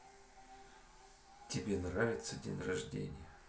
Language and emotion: Russian, neutral